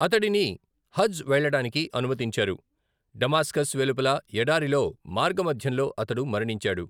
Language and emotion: Telugu, neutral